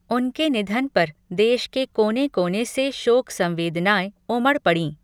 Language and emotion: Hindi, neutral